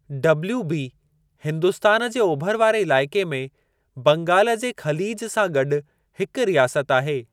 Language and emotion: Sindhi, neutral